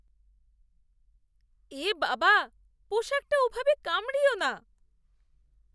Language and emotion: Bengali, disgusted